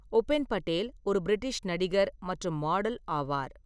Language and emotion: Tamil, neutral